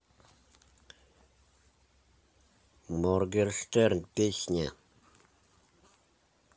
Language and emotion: Russian, neutral